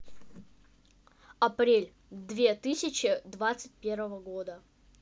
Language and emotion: Russian, neutral